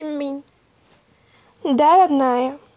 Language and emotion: Russian, neutral